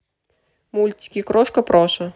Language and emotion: Russian, neutral